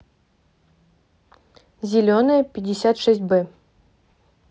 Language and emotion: Russian, neutral